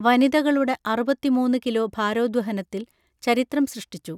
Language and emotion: Malayalam, neutral